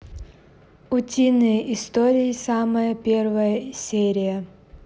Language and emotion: Russian, neutral